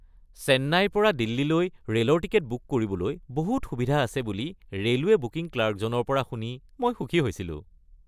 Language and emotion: Assamese, happy